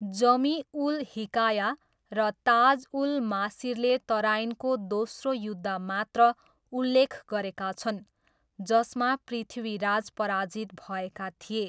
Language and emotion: Nepali, neutral